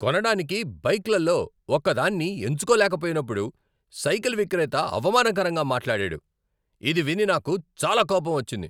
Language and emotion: Telugu, angry